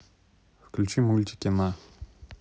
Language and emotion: Russian, neutral